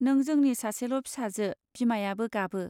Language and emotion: Bodo, neutral